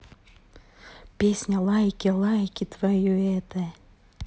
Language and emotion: Russian, positive